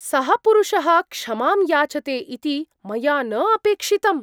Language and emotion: Sanskrit, surprised